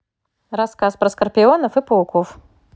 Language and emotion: Russian, positive